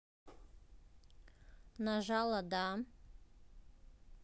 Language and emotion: Russian, neutral